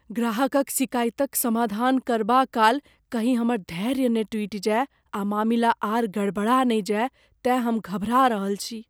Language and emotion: Maithili, fearful